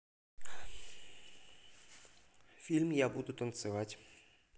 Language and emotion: Russian, neutral